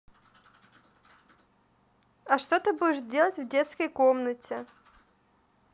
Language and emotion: Russian, neutral